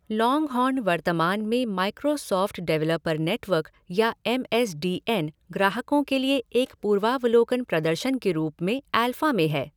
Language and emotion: Hindi, neutral